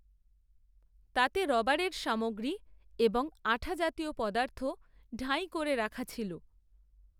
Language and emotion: Bengali, neutral